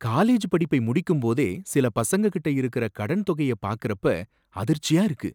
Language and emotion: Tamil, surprised